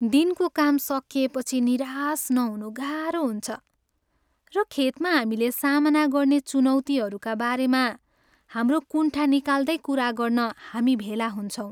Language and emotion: Nepali, sad